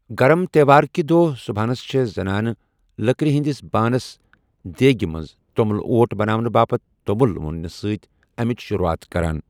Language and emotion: Kashmiri, neutral